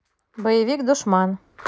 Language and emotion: Russian, neutral